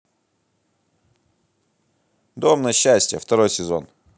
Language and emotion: Russian, positive